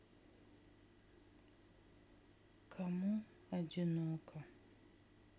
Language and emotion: Russian, sad